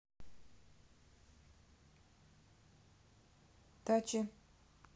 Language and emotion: Russian, neutral